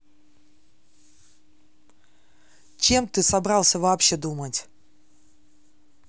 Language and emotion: Russian, angry